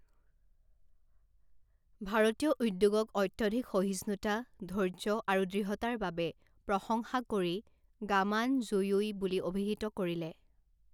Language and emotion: Assamese, neutral